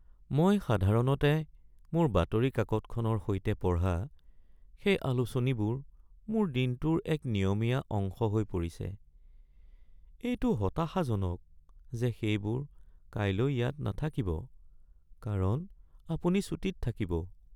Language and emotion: Assamese, sad